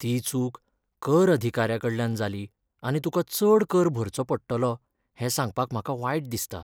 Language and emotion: Goan Konkani, sad